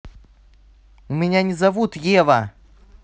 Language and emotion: Russian, angry